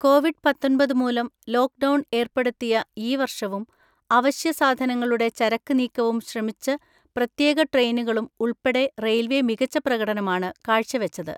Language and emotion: Malayalam, neutral